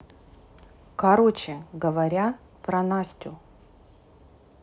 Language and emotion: Russian, neutral